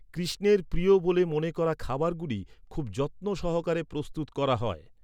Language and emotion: Bengali, neutral